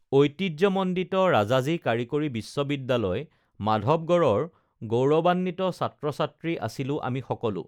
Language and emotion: Assamese, neutral